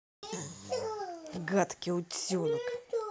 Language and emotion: Russian, angry